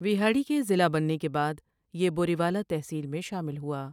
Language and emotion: Urdu, neutral